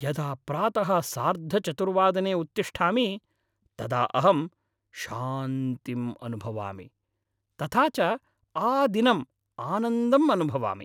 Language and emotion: Sanskrit, happy